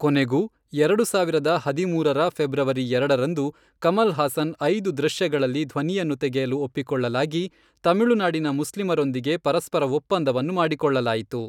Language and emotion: Kannada, neutral